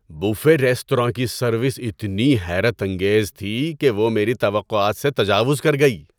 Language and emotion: Urdu, surprised